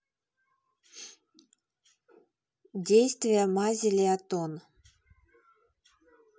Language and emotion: Russian, neutral